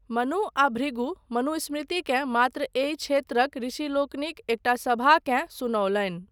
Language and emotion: Maithili, neutral